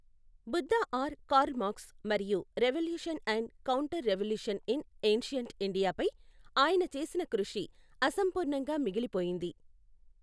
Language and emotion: Telugu, neutral